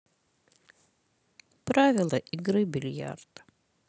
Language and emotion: Russian, sad